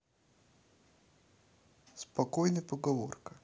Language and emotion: Russian, neutral